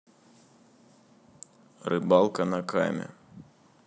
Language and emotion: Russian, neutral